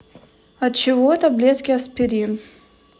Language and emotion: Russian, neutral